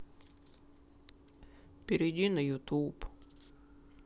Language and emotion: Russian, sad